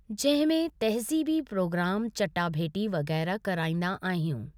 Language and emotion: Sindhi, neutral